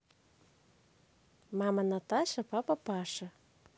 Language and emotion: Russian, positive